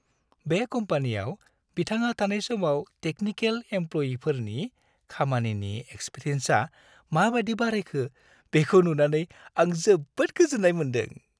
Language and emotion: Bodo, happy